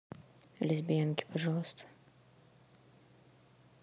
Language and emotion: Russian, neutral